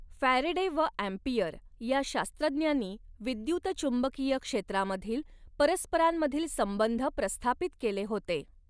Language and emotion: Marathi, neutral